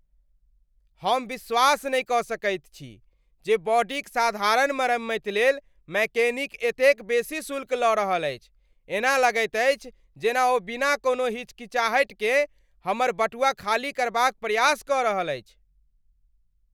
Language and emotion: Maithili, angry